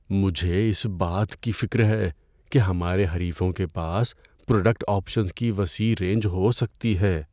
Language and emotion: Urdu, fearful